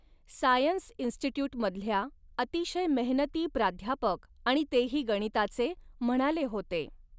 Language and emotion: Marathi, neutral